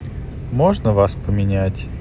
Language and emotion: Russian, neutral